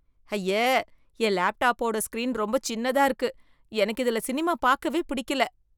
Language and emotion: Tamil, disgusted